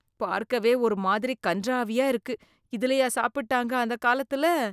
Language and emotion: Tamil, disgusted